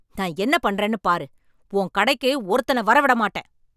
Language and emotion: Tamil, angry